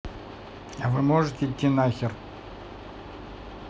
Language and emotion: Russian, neutral